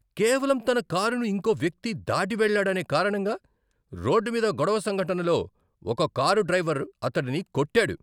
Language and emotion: Telugu, angry